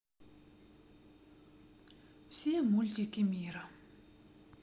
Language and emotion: Russian, sad